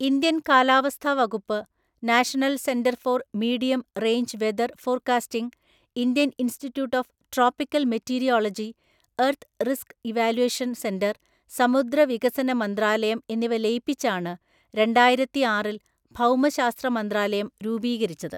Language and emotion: Malayalam, neutral